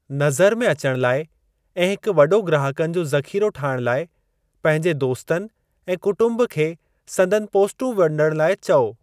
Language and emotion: Sindhi, neutral